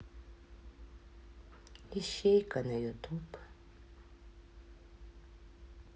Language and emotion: Russian, sad